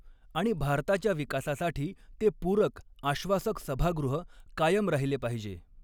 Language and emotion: Marathi, neutral